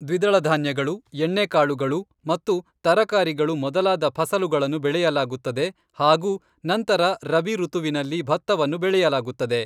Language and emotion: Kannada, neutral